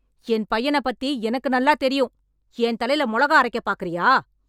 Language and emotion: Tamil, angry